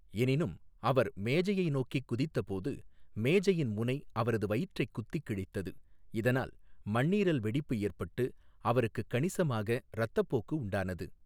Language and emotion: Tamil, neutral